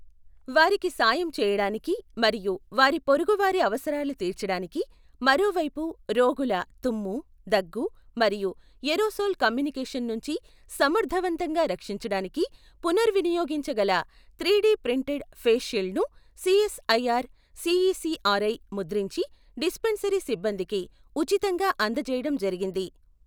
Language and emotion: Telugu, neutral